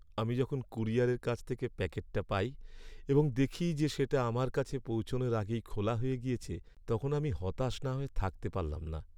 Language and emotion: Bengali, sad